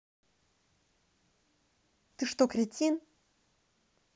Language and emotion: Russian, angry